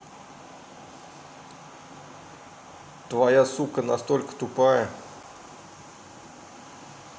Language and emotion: Russian, neutral